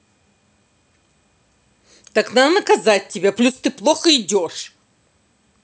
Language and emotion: Russian, angry